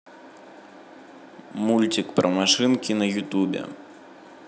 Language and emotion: Russian, neutral